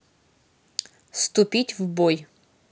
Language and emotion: Russian, neutral